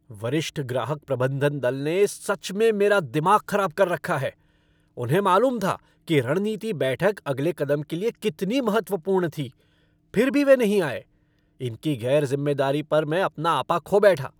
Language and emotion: Hindi, angry